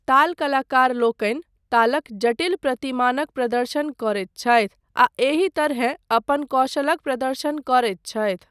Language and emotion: Maithili, neutral